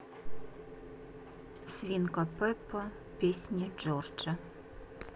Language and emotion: Russian, neutral